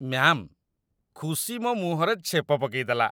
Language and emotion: Odia, disgusted